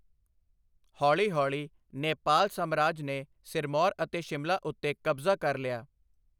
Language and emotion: Punjabi, neutral